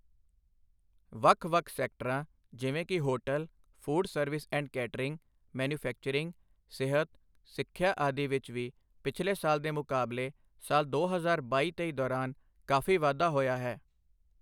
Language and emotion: Punjabi, neutral